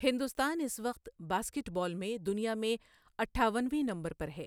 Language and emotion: Urdu, neutral